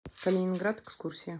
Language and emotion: Russian, neutral